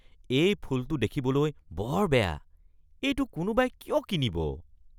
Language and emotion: Assamese, disgusted